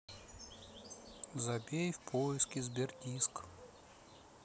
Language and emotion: Russian, neutral